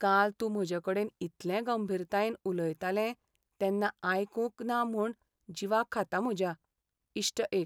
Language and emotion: Goan Konkani, sad